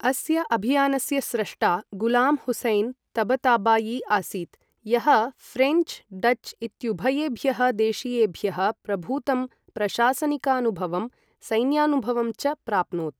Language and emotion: Sanskrit, neutral